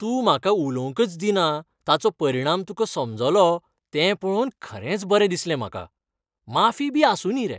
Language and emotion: Goan Konkani, happy